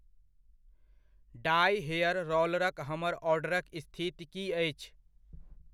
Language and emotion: Maithili, neutral